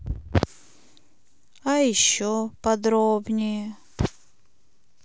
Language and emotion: Russian, sad